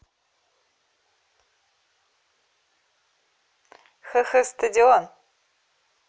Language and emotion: Russian, positive